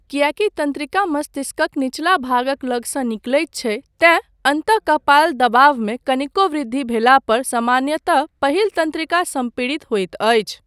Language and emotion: Maithili, neutral